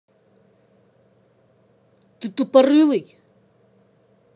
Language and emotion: Russian, angry